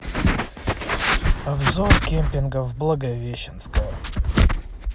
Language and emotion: Russian, neutral